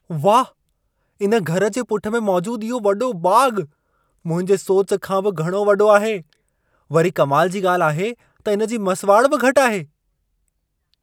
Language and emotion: Sindhi, surprised